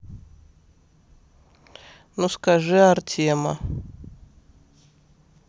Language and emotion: Russian, neutral